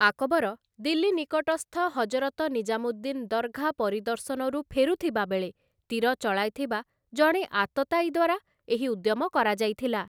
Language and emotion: Odia, neutral